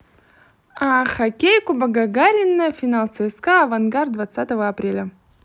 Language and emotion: Russian, positive